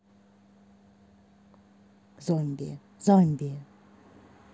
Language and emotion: Russian, neutral